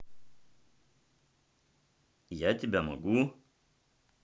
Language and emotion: Russian, neutral